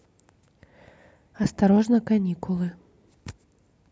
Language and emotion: Russian, neutral